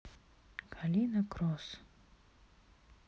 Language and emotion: Russian, neutral